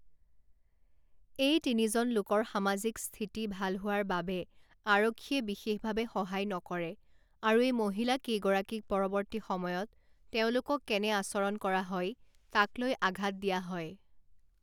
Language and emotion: Assamese, neutral